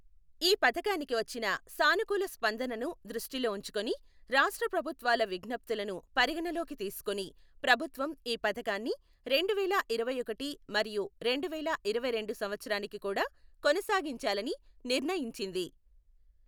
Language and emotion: Telugu, neutral